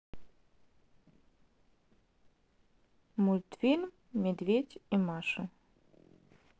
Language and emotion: Russian, neutral